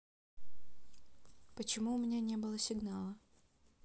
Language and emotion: Russian, sad